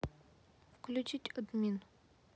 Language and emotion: Russian, neutral